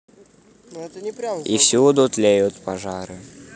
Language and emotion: Russian, neutral